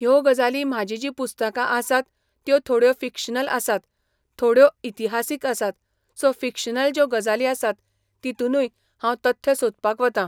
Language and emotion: Goan Konkani, neutral